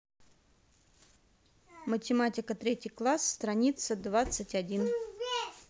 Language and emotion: Russian, neutral